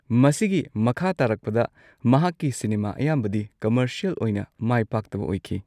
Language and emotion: Manipuri, neutral